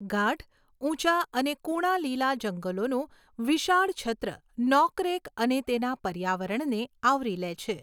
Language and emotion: Gujarati, neutral